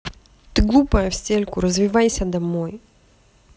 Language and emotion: Russian, angry